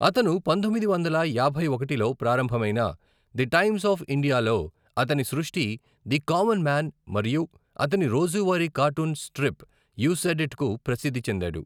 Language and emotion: Telugu, neutral